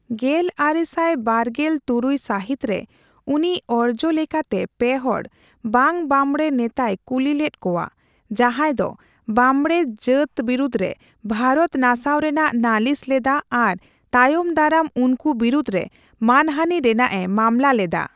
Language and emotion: Santali, neutral